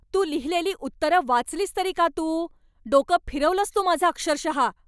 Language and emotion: Marathi, angry